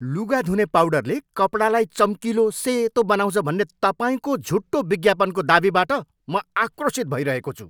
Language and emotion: Nepali, angry